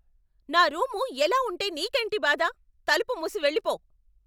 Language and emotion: Telugu, angry